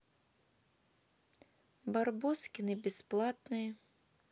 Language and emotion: Russian, neutral